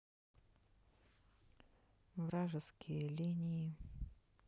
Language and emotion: Russian, sad